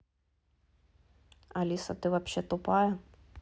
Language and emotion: Russian, angry